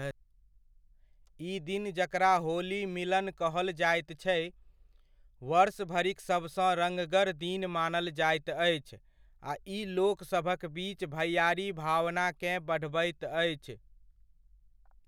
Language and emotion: Maithili, neutral